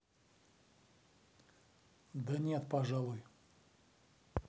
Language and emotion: Russian, neutral